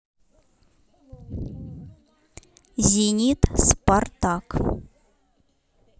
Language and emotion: Russian, neutral